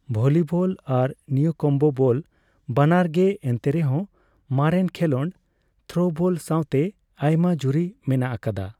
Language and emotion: Santali, neutral